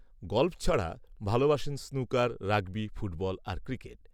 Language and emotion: Bengali, neutral